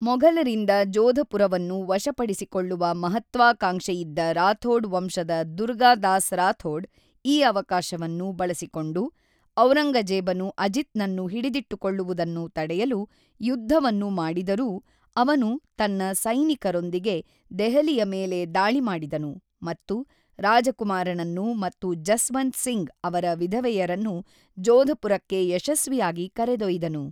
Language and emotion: Kannada, neutral